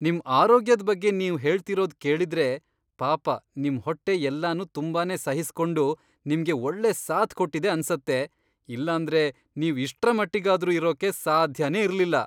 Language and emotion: Kannada, surprised